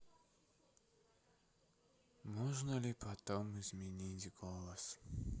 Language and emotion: Russian, sad